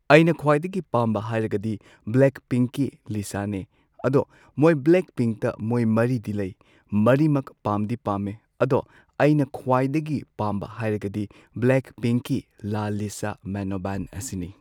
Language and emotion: Manipuri, neutral